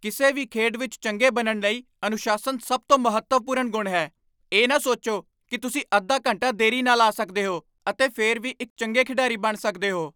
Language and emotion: Punjabi, angry